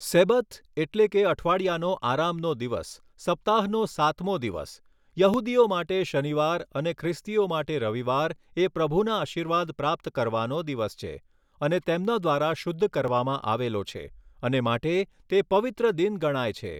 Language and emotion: Gujarati, neutral